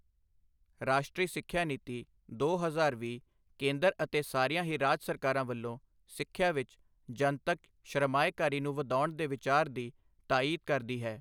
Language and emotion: Punjabi, neutral